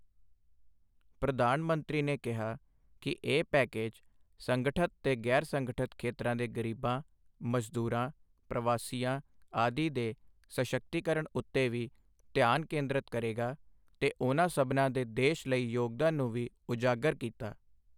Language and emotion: Punjabi, neutral